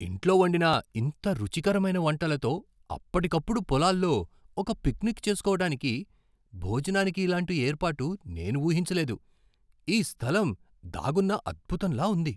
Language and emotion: Telugu, surprised